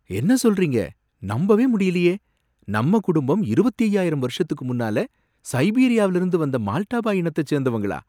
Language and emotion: Tamil, surprised